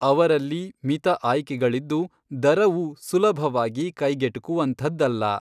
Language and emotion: Kannada, neutral